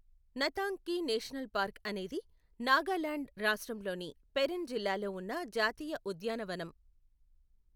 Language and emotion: Telugu, neutral